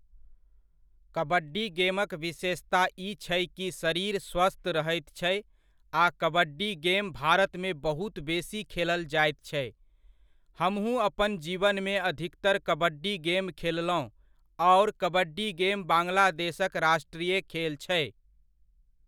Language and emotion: Maithili, neutral